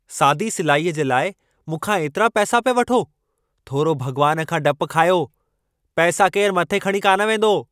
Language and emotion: Sindhi, angry